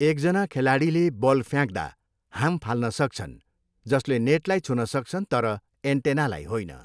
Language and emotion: Nepali, neutral